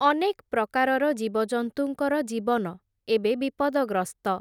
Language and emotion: Odia, neutral